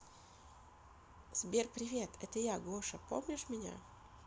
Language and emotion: Russian, positive